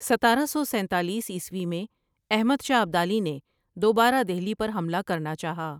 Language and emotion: Urdu, neutral